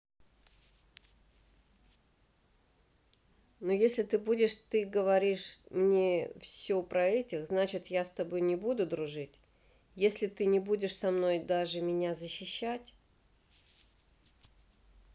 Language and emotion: Russian, neutral